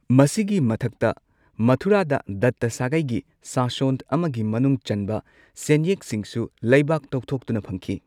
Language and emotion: Manipuri, neutral